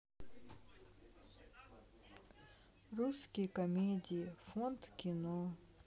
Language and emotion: Russian, sad